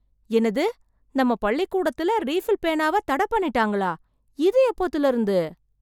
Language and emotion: Tamil, surprised